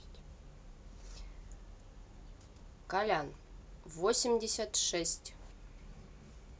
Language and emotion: Russian, neutral